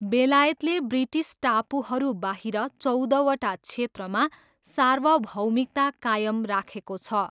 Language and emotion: Nepali, neutral